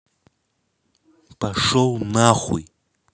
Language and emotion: Russian, angry